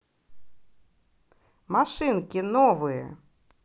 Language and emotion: Russian, positive